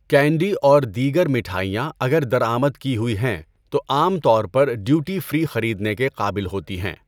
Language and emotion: Urdu, neutral